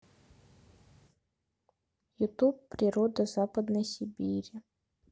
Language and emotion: Russian, neutral